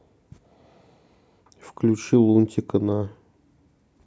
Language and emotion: Russian, neutral